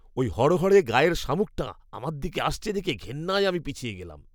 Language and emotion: Bengali, disgusted